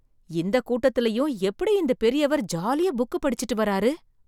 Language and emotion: Tamil, surprised